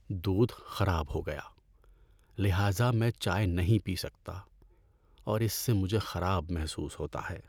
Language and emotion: Urdu, sad